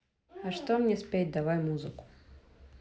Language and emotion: Russian, neutral